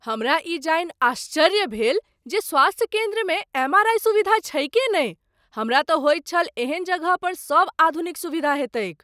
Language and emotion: Maithili, surprised